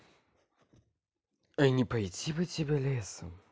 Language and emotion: Russian, neutral